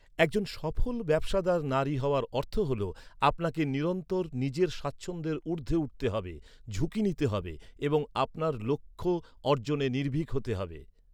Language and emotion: Bengali, neutral